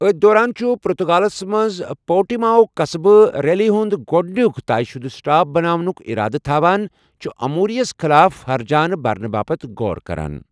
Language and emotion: Kashmiri, neutral